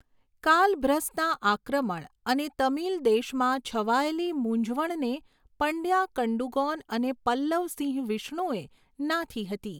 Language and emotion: Gujarati, neutral